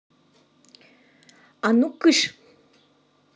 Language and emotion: Russian, angry